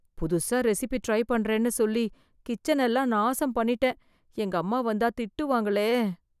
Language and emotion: Tamil, fearful